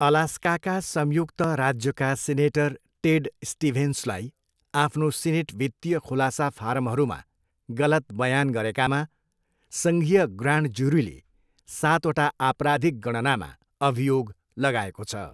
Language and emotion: Nepali, neutral